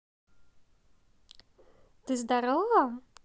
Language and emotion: Russian, positive